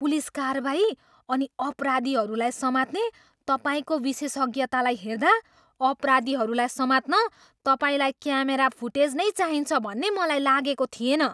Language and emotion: Nepali, surprised